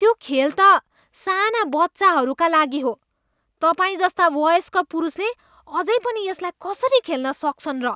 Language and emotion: Nepali, disgusted